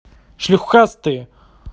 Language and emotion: Russian, angry